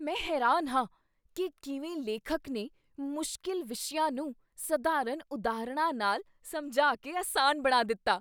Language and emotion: Punjabi, surprised